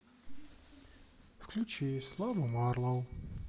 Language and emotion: Russian, neutral